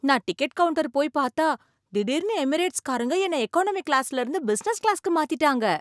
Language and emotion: Tamil, surprised